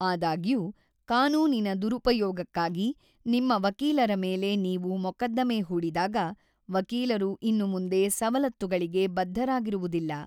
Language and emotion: Kannada, neutral